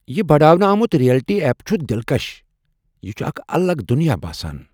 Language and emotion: Kashmiri, surprised